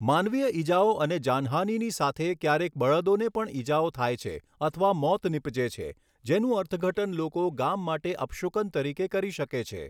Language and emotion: Gujarati, neutral